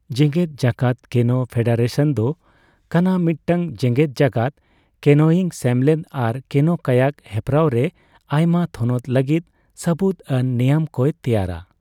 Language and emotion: Santali, neutral